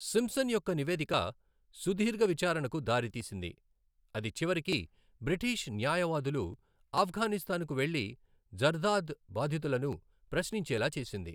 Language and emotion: Telugu, neutral